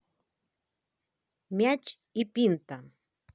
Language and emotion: Russian, positive